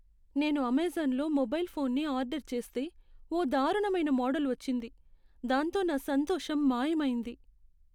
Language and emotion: Telugu, sad